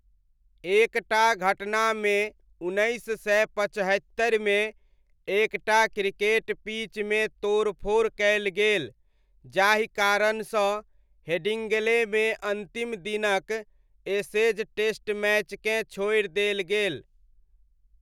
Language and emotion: Maithili, neutral